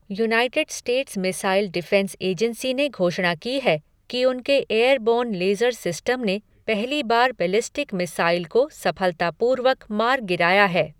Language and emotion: Hindi, neutral